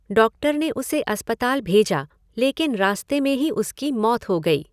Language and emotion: Hindi, neutral